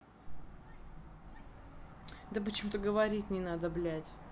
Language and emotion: Russian, angry